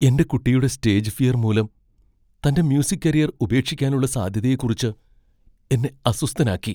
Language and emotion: Malayalam, fearful